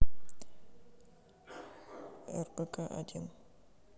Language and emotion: Russian, neutral